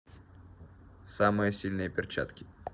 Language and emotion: Russian, neutral